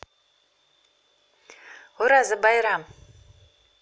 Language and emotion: Russian, positive